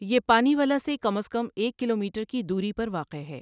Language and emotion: Urdu, neutral